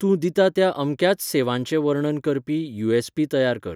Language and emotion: Goan Konkani, neutral